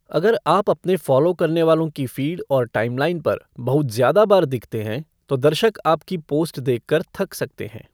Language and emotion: Hindi, neutral